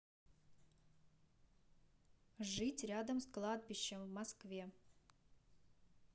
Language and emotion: Russian, neutral